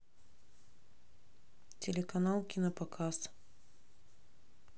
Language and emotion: Russian, neutral